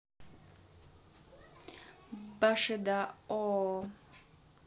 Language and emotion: Russian, neutral